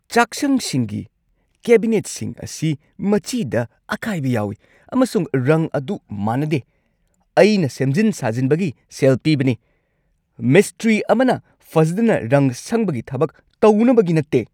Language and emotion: Manipuri, angry